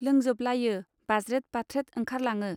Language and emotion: Bodo, neutral